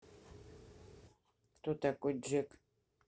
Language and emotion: Russian, neutral